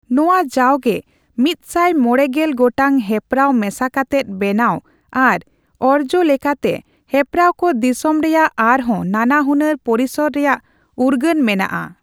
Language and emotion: Santali, neutral